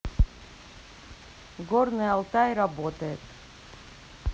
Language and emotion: Russian, neutral